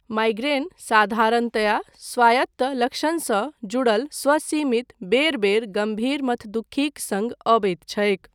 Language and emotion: Maithili, neutral